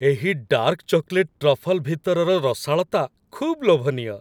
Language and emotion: Odia, happy